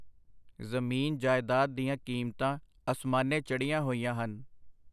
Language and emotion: Punjabi, neutral